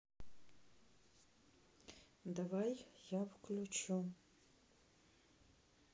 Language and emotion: Russian, neutral